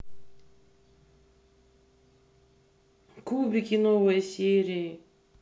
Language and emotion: Russian, neutral